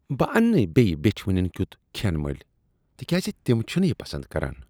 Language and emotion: Kashmiri, disgusted